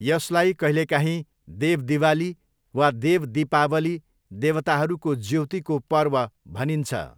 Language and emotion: Nepali, neutral